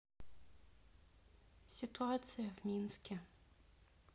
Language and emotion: Russian, sad